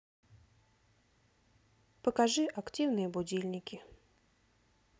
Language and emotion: Russian, neutral